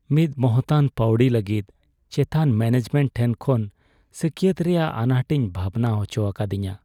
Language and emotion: Santali, sad